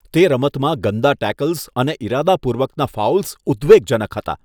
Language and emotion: Gujarati, disgusted